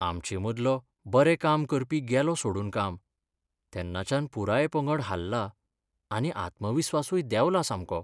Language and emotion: Goan Konkani, sad